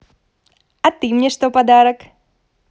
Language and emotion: Russian, positive